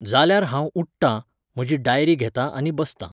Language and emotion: Goan Konkani, neutral